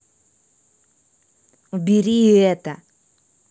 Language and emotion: Russian, angry